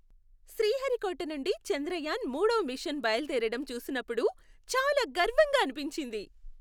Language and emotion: Telugu, happy